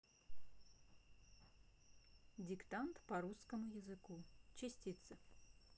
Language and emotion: Russian, neutral